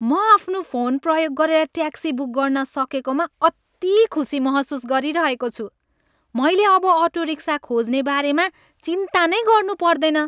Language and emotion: Nepali, happy